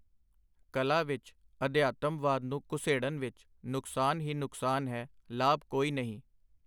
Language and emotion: Punjabi, neutral